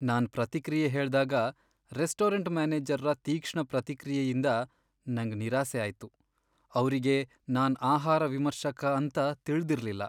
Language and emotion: Kannada, sad